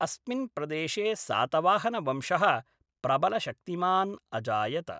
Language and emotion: Sanskrit, neutral